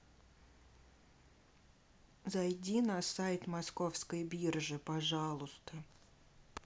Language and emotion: Russian, neutral